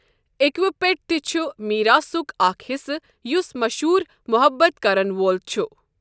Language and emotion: Kashmiri, neutral